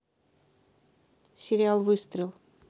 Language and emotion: Russian, neutral